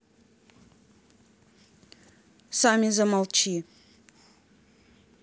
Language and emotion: Russian, angry